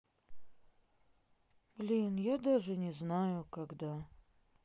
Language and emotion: Russian, sad